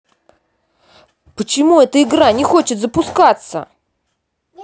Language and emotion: Russian, angry